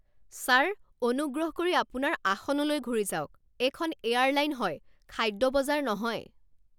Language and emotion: Assamese, angry